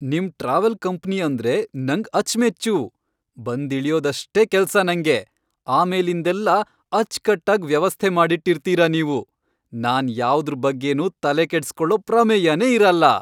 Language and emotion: Kannada, happy